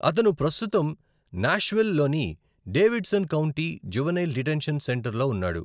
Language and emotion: Telugu, neutral